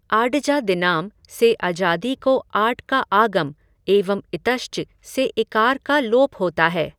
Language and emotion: Hindi, neutral